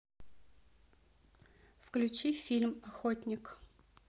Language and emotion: Russian, neutral